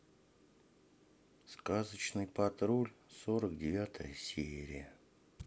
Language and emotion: Russian, sad